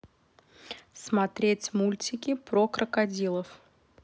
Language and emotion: Russian, neutral